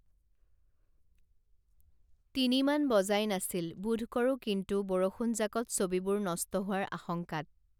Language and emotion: Assamese, neutral